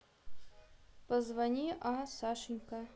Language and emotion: Russian, neutral